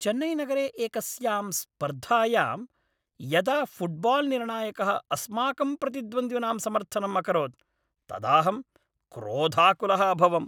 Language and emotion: Sanskrit, angry